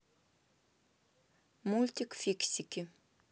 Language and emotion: Russian, neutral